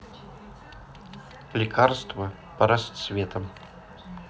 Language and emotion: Russian, neutral